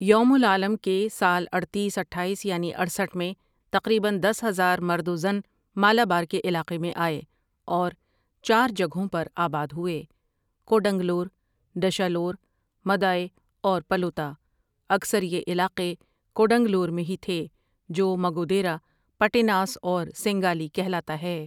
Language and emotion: Urdu, neutral